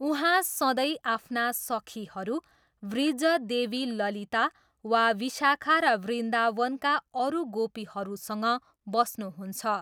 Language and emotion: Nepali, neutral